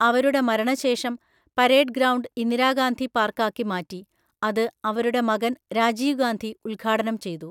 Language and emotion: Malayalam, neutral